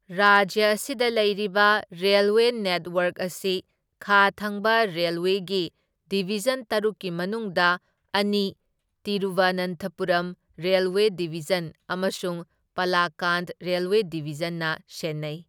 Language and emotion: Manipuri, neutral